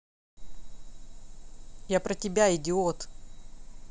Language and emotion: Russian, angry